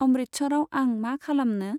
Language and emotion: Bodo, neutral